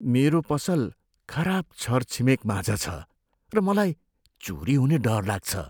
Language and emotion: Nepali, fearful